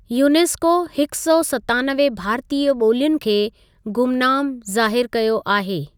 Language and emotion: Sindhi, neutral